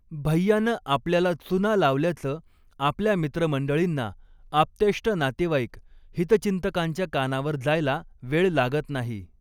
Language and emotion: Marathi, neutral